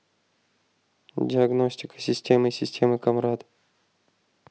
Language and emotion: Russian, neutral